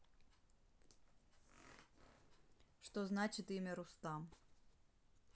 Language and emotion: Russian, neutral